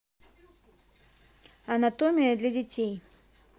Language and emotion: Russian, neutral